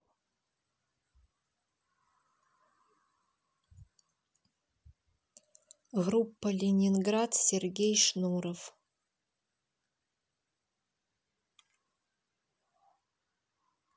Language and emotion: Russian, neutral